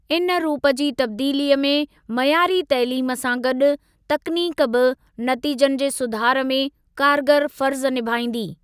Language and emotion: Sindhi, neutral